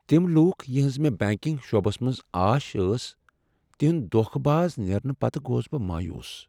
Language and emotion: Kashmiri, sad